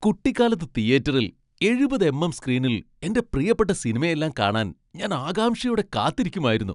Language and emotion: Malayalam, happy